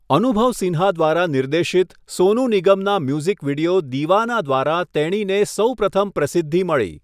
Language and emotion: Gujarati, neutral